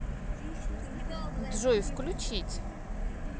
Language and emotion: Russian, neutral